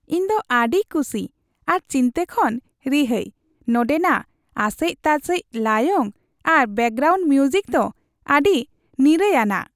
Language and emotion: Santali, happy